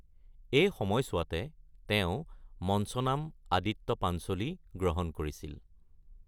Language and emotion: Assamese, neutral